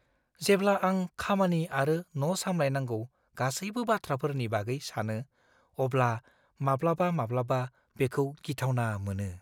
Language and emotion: Bodo, fearful